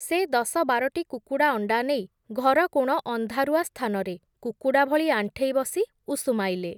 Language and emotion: Odia, neutral